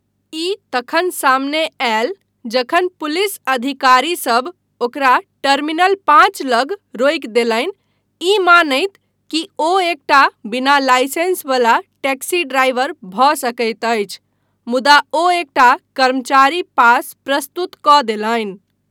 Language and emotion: Maithili, neutral